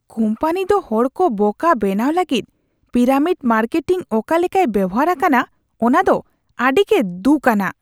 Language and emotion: Santali, disgusted